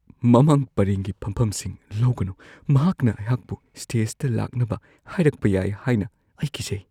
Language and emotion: Manipuri, fearful